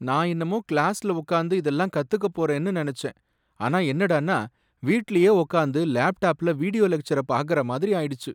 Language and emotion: Tamil, sad